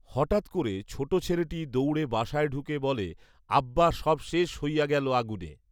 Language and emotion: Bengali, neutral